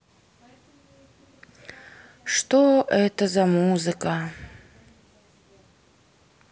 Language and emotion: Russian, sad